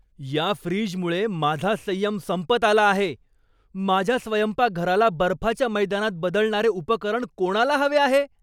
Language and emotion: Marathi, angry